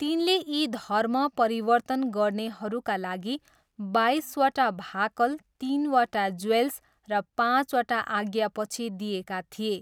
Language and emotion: Nepali, neutral